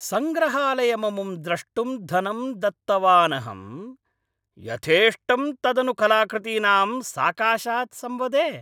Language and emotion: Sanskrit, angry